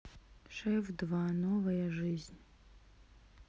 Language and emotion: Russian, sad